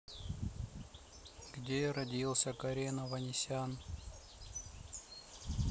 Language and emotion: Russian, neutral